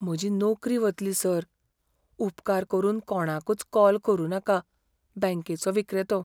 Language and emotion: Goan Konkani, fearful